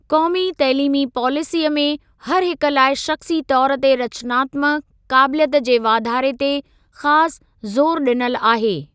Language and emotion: Sindhi, neutral